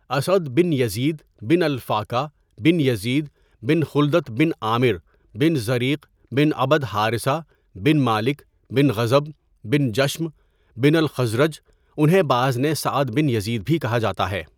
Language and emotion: Urdu, neutral